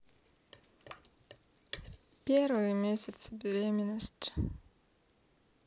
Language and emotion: Russian, sad